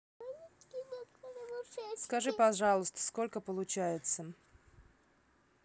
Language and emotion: Russian, neutral